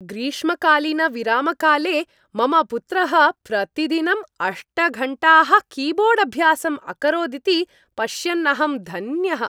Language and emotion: Sanskrit, happy